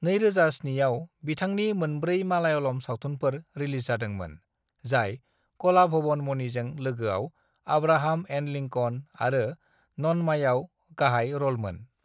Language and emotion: Bodo, neutral